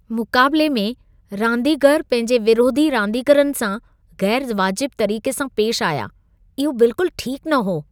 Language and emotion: Sindhi, disgusted